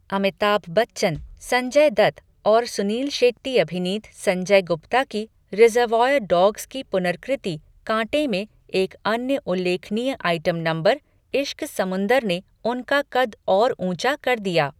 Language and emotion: Hindi, neutral